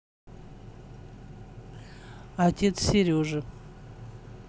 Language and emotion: Russian, neutral